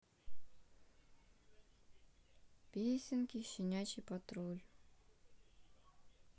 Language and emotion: Russian, neutral